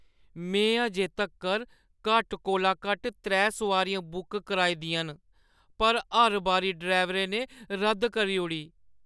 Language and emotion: Dogri, sad